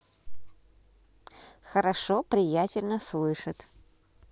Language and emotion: Russian, positive